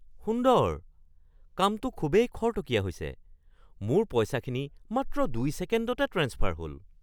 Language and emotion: Assamese, surprised